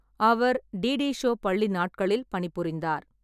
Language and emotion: Tamil, neutral